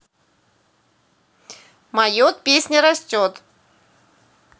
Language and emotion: Russian, neutral